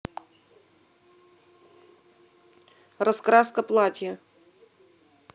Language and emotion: Russian, neutral